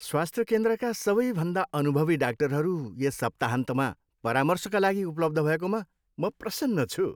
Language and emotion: Nepali, happy